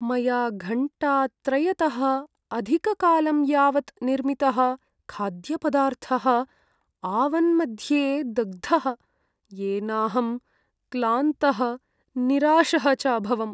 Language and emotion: Sanskrit, sad